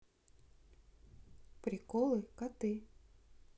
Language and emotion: Russian, neutral